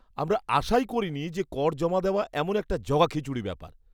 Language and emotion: Bengali, disgusted